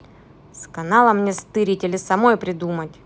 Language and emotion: Russian, angry